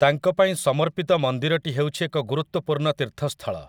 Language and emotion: Odia, neutral